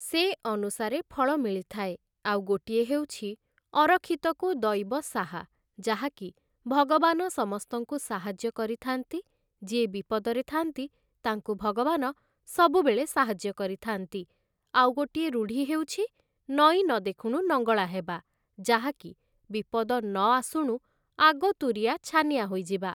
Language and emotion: Odia, neutral